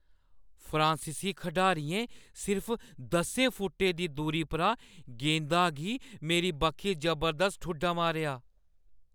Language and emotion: Dogri, fearful